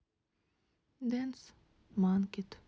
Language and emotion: Russian, sad